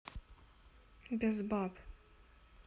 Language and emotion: Russian, neutral